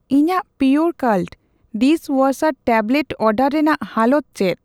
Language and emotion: Santali, neutral